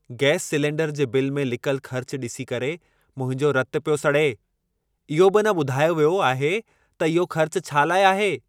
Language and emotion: Sindhi, angry